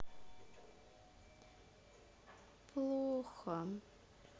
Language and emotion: Russian, sad